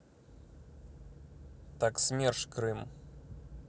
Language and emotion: Russian, neutral